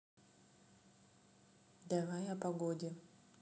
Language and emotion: Russian, neutral